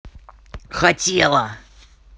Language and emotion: Russian, angry